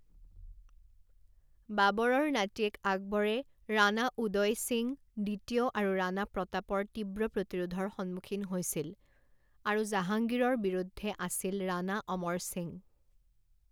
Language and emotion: Assamese, neutral